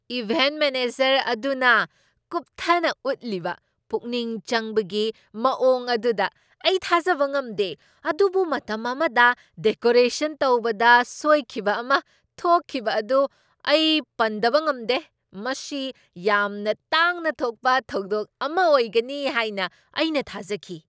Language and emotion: Manipuri, surprised